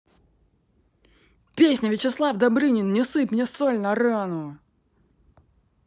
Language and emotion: Russian, angry